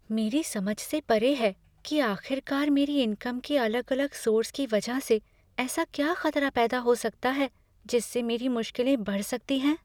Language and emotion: Hindi, fearful